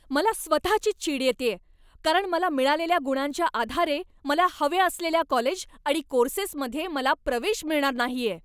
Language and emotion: Marathi, angry